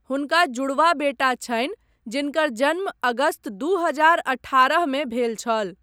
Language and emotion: Maithili, neutral